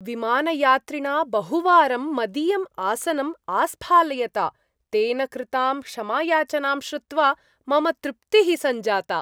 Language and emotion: Sanskrit, happy